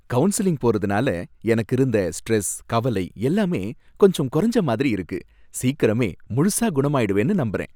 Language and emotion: Tamil, happy